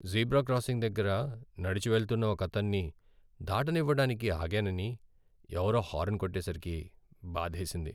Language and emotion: Telugu, sad